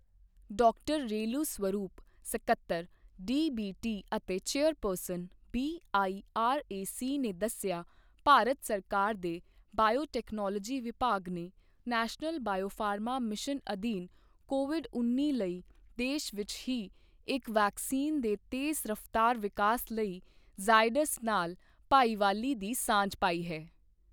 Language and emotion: Punjabi, neutral